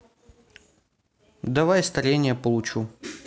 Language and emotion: Russian, neutral